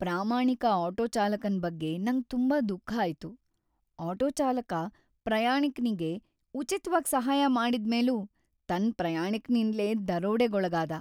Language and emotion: Kannada, sad